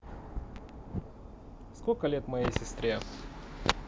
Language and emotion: Russian, neutral